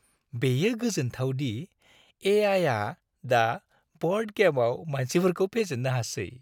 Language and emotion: Bodo, happy